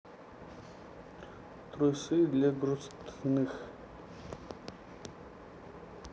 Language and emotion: Russian, neutral